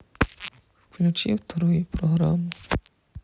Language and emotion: Russian, sad